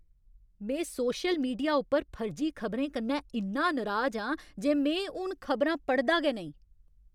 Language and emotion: Dogri, angry